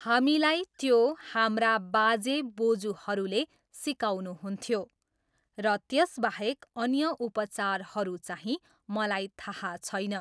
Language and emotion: Nepali, neutral